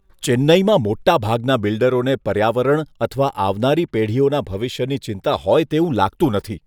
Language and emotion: Gujarati, disgusted